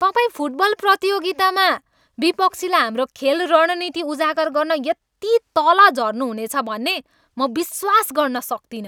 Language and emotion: Nepali, angry